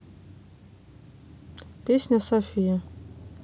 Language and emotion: Russian, neutral